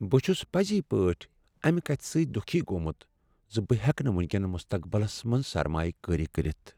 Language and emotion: Kashmiri, sad